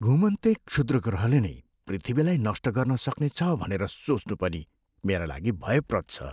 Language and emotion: Nepali, fearful